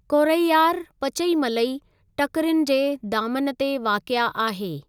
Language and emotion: Sindhi, neutral